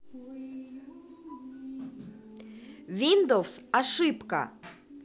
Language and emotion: Russian, positive